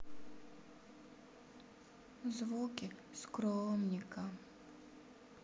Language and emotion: Russian, sad